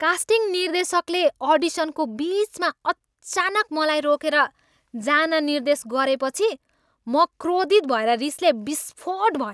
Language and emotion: Nepali, angry